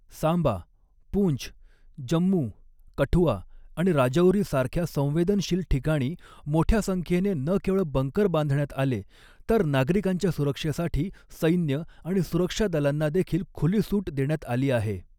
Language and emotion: Marathi, neutral